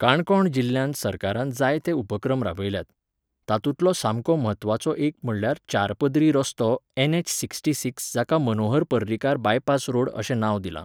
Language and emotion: Goan Konkani, neutral